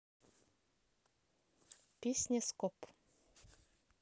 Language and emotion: Russian, neutral